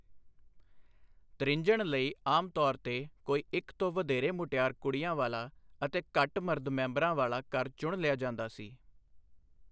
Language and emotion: Punjabi, neutral